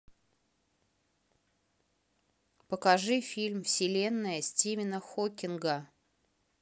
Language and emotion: Russian, neutral